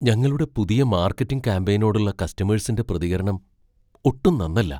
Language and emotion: Malayalam, fearful